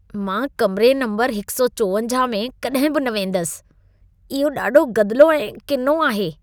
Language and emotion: Sindhi, disgusted